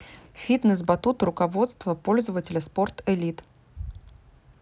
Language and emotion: Russian, neutral